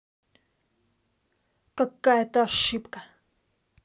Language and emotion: Russian, angry